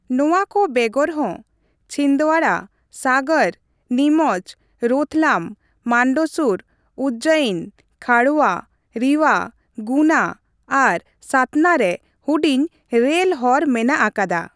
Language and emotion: Santali, neutral